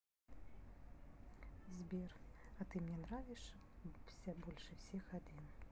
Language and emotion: Russian, neutral